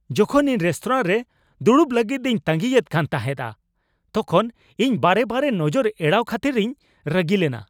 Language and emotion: Santali, angry